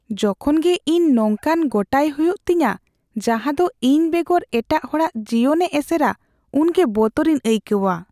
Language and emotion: Santali, fearful